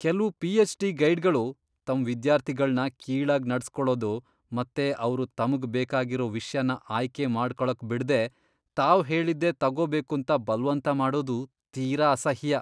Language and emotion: Kannada, disgusted